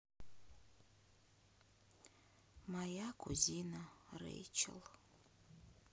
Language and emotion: Russian, sad